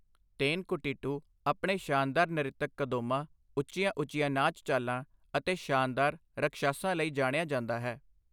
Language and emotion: Punjabi, neutral